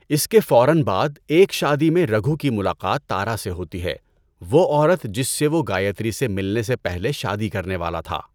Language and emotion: Urdu, neutral